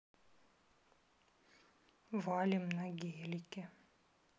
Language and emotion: Russian, sad